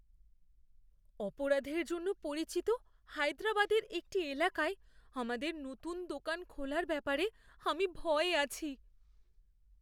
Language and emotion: Bengali, fearful